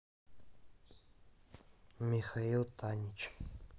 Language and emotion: Russian, neutral